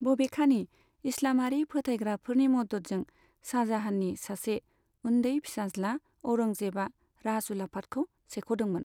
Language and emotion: Bodo, neutral